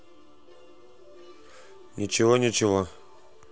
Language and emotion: Russian, neutral